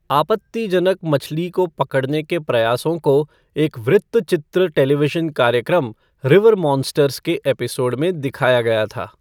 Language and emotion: Hindi, neutral